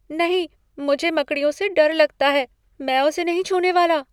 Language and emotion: Hindi, fearful